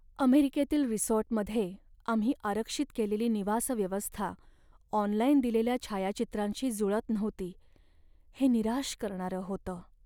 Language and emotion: Marathi, sad